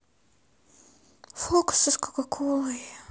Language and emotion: Russian, sad